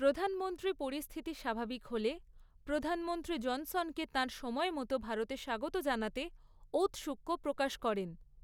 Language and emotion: Bengali, neutral